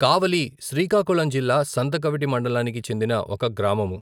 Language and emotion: Telugu, neutral